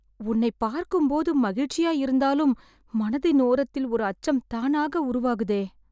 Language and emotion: Tamil, fearful